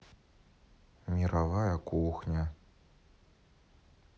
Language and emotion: Russian, sad